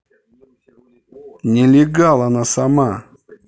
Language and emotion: Russian, angry